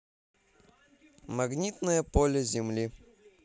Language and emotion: Russian, neutral